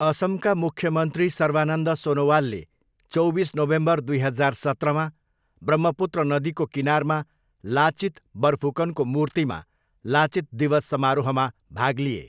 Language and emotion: Nepali, neutral